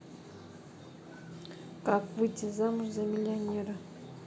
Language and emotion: Russian, neutral